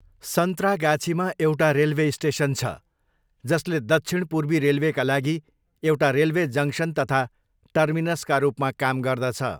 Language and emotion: Nepali, neutral